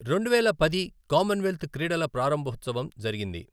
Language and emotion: Telugu, neutral